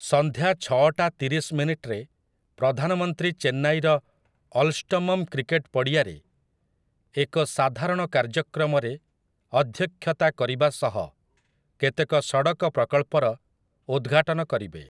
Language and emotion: Odia, neutral